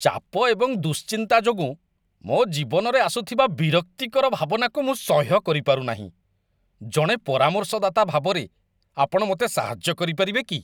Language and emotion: Odia, disgusted